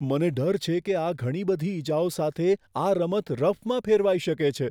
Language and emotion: Gujarati, fearful